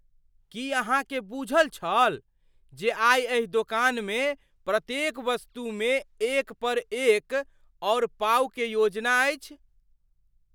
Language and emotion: Maithili, surprised